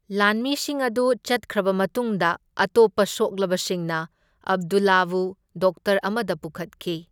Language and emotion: Manipuri, neutral